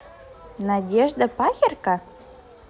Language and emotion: Russian, positive